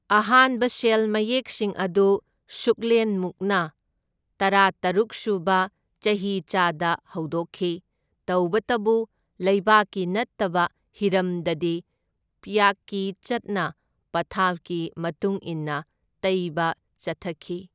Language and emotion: Manipuri, neutral